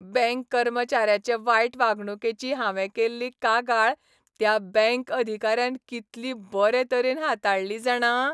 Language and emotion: Goan Konkani, happy